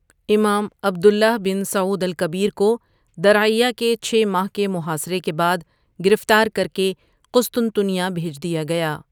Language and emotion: Urdu, neutral